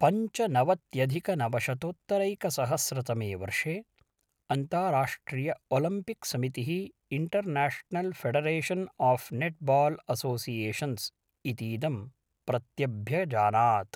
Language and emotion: Sanskrit, neutral